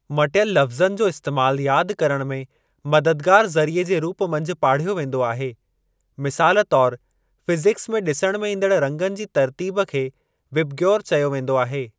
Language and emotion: Sindhi, neutral